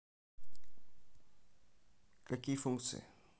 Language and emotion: Russian, neutral